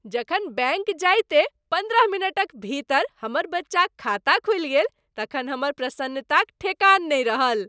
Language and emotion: Maithili, happy